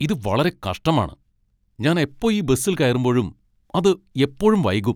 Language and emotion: Malayalam, angry